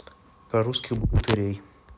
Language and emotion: Russian, neutral